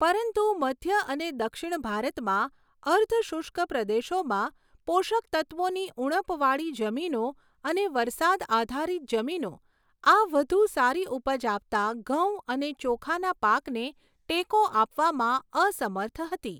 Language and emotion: Gujarati, neutral